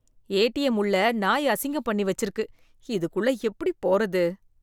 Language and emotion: Tamil, disgusted